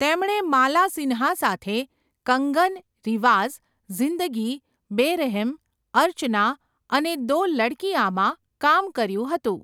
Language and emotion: Gujarati, neutral